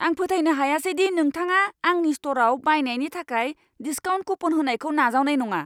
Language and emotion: Bodo, angry